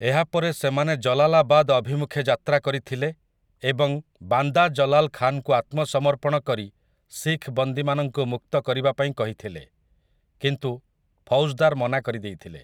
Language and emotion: Odia, neutral